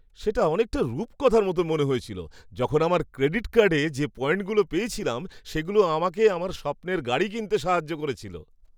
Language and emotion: Bengali, happy